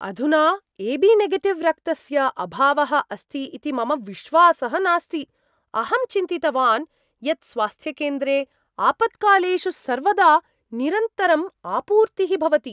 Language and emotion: Sanskrit, surprised